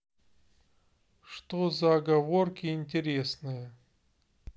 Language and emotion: Russian, neutral